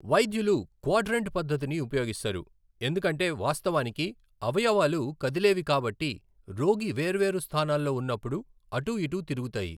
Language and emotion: Telugu, neutral